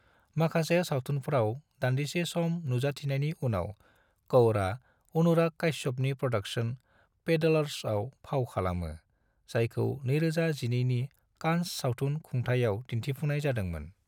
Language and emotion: Bodo, neutral